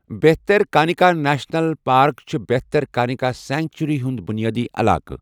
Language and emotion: Kashmiri, neutral